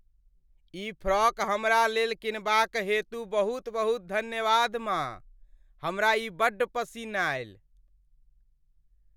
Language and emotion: Maithili, happy